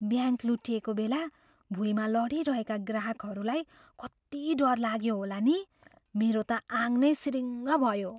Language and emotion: Nepali, fearful